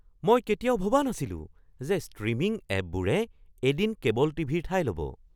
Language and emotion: Assamese, surprised